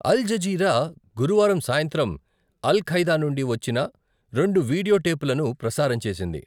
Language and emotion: Telugu, neutral